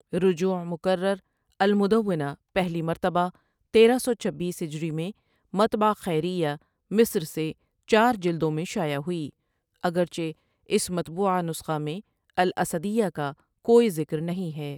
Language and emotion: Urdu, neutral